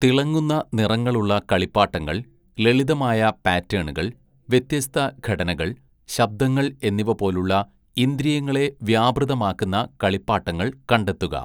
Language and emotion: Malayalam, neutral